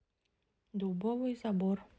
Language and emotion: Russian, neutral